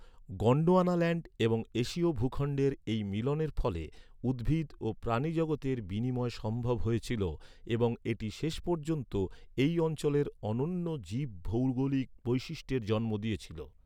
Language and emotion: Bengali, neutral